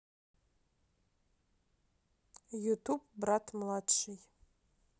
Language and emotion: Russian, neutral